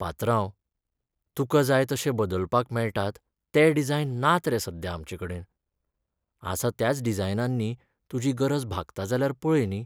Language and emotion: Goan Konkani, sad